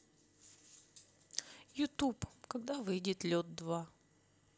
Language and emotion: Russian, sad